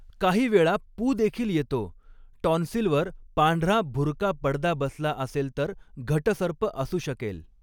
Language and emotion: Marathi, neutral